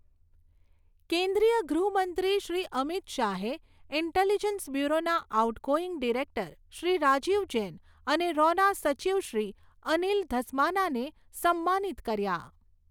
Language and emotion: Gujarati, neutral